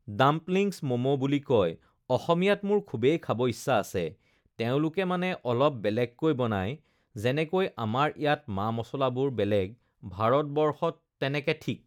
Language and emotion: Assamese, neutral